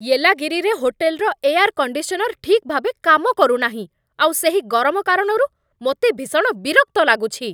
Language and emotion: Odia, angry